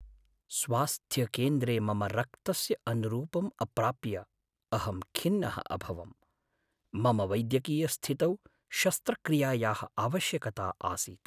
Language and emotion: Sanskrit, sad